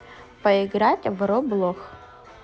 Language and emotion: Russian, neutral